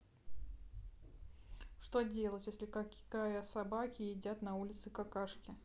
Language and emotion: Russian, neutral